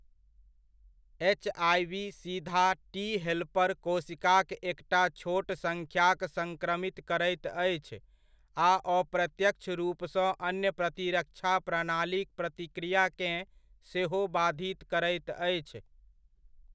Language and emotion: Maithili, neutral